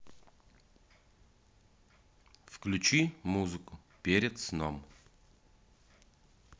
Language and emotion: Russian, neutral